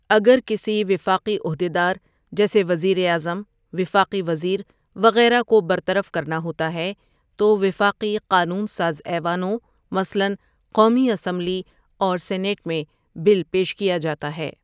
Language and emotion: Urdu, neutral